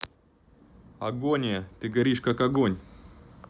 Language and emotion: Russian, neutral